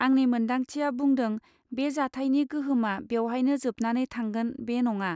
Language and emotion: Bodo, neutral